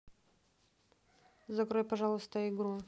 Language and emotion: Russian, neutral